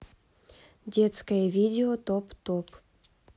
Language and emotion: Russian, neutral